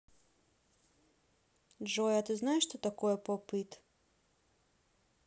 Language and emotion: Russian, neutral